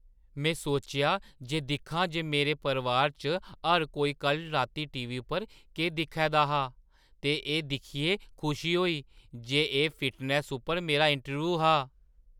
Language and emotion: Dogri, surprised